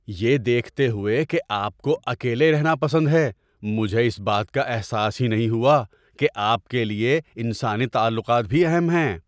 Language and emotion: Urdu, surprised